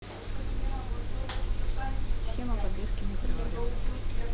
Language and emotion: Russian, neutral